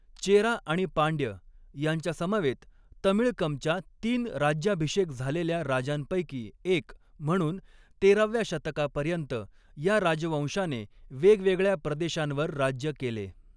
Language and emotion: Marathi, neutral